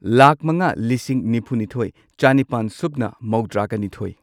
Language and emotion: Manipuri, neutral